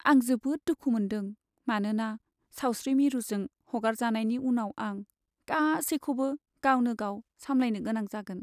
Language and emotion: Bodo, sad